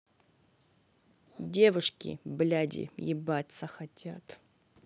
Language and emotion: Russian, angry